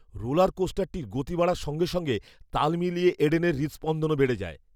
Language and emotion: Bengali, fearful